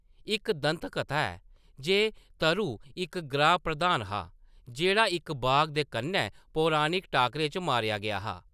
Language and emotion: Dogri, neutral